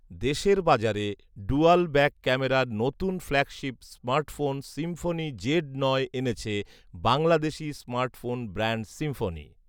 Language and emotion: Bengali, neutral